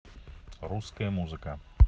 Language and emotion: Russian, neutral